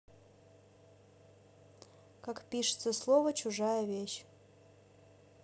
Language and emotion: Russian, neutral